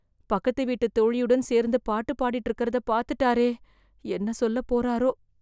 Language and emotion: Tamil, fearful